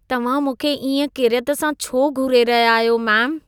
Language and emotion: Sindhi, disgusted